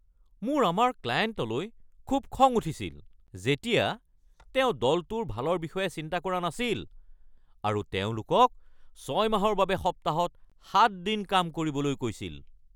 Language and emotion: Assamese, angry